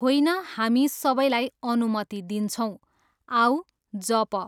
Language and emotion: Nepali, neutral